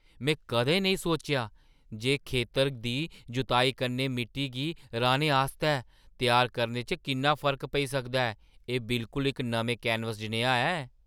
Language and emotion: Dogri, surprised